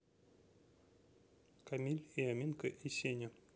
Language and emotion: Russian, neutral